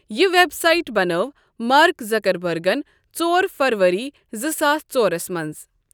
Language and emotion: Kashmiri, neutral